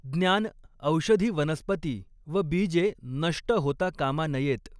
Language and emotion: Marathi, neutral